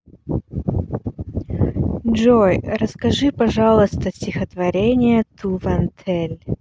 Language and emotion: Russian, neutral